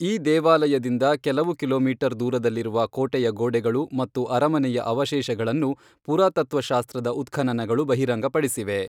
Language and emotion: Kannada, neutral